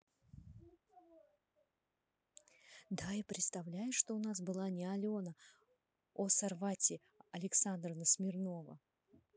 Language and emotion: Russian, positive